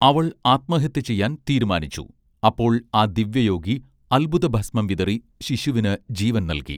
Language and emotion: Malayalam, neutral